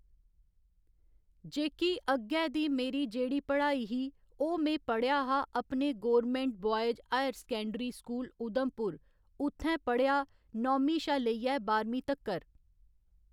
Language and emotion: Dogri, neutral